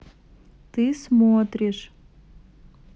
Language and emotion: Russian, neutral